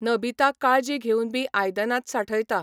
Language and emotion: Goan Konkani, neutral